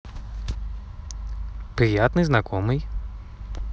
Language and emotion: Russian, positive